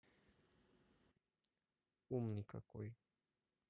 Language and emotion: Russian, neutral